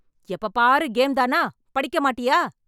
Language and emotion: Tamil, angry